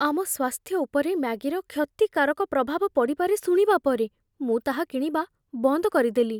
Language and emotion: Odia, fearful